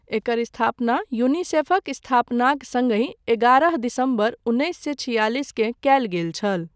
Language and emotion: Maithili, neutral